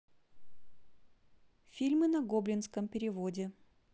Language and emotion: Russian, neutral